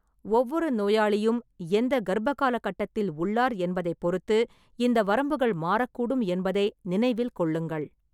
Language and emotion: Tamil, neutral